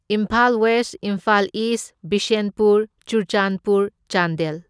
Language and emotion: Manipuri, neutral